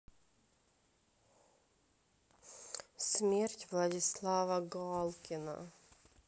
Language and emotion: Russian, sad